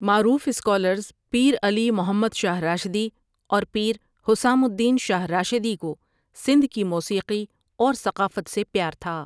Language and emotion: Urdu, neutral